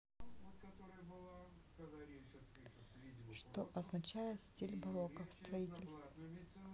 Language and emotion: Russian, neutral